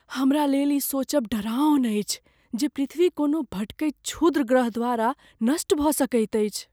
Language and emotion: Maithili, fearful